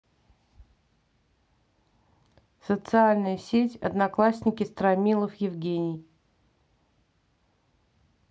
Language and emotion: Russian, neutral